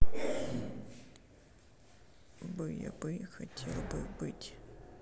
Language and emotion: Russian, sad